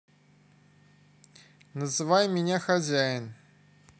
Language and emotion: Russian, neutral